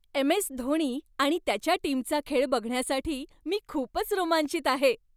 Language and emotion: Marathi, happy